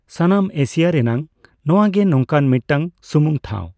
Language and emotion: Santali, neutral